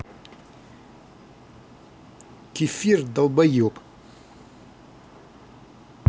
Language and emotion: Russian, angry